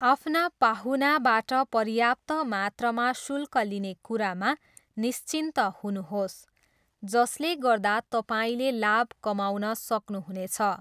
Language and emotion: Nepali, neutral